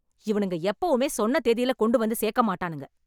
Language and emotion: Tamil, angry